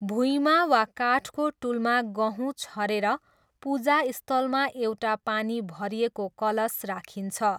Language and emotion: Nepali, neutral